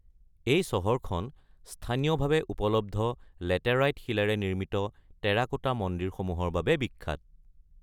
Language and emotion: Assamese, neutral